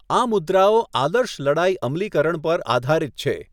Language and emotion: Gujarati, neutral